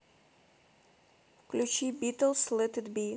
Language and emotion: Russian, neutral